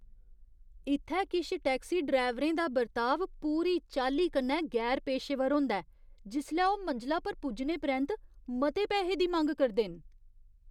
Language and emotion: Dogri, disgusted